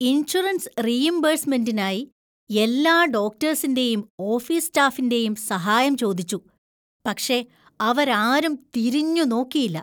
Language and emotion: Malayalam, disgusted